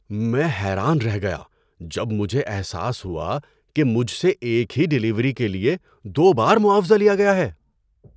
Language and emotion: Urdu, surprised